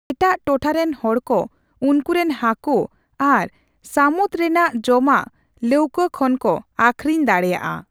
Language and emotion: Santali, neutral